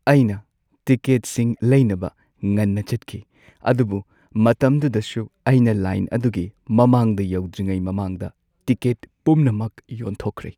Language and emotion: Manipuri, sad